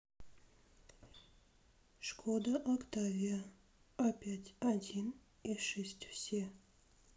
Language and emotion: Russian, neutral